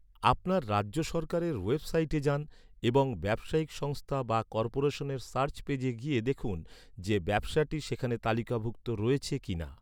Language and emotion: Bengali, neutral